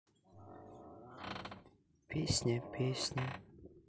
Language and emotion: Russian, sad